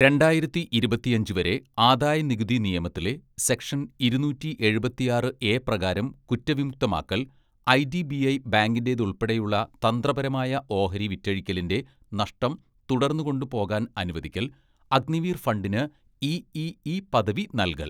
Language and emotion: Malayalam, neutral